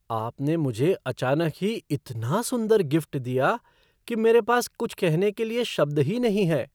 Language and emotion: Hindi, surprised